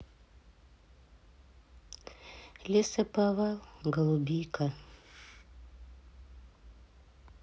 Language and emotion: Russian, sad